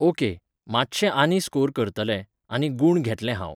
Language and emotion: Goan Konkani, neutral